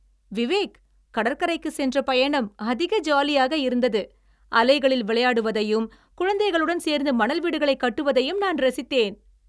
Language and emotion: Tamil, happy